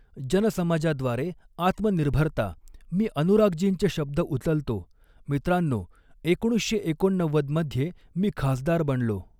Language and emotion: Marathi, neutral